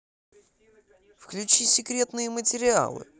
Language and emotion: Russian, positive